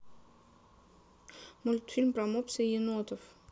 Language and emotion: Russian, neutral